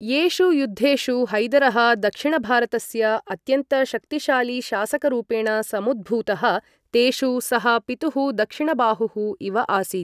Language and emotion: Sanskrit, neutral